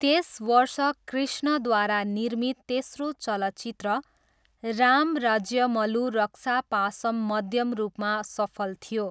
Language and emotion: Nepali, neutral